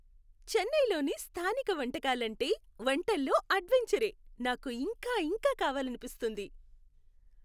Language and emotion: Telugu, happy